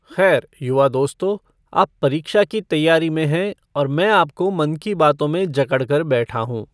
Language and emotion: Hindi, neutral